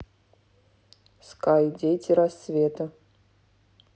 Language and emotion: Russian, neutral